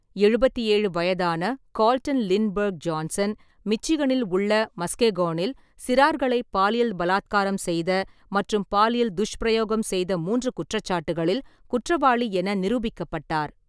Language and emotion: Tamil, neutral